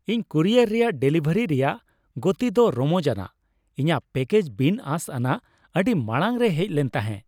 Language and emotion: Santali, happy